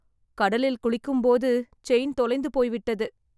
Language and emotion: Tamil, sad